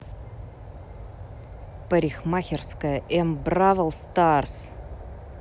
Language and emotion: Russian, angry